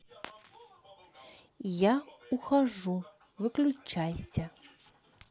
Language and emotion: Russian, neutral